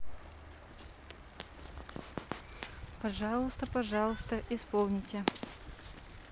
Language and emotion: Russian, neutral